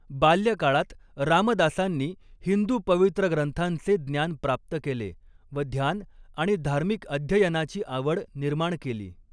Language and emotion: Marathi, neutral